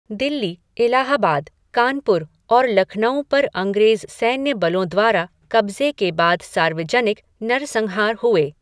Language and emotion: Hindi, neutral